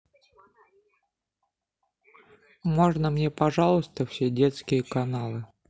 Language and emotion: Russian, neutral